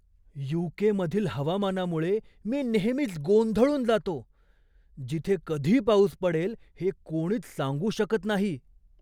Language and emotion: Marathi, surprised